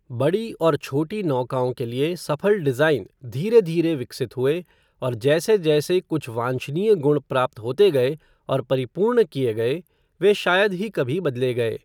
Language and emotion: Hindi, neutral